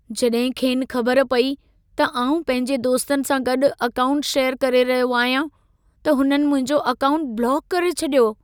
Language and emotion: Sindhi, sad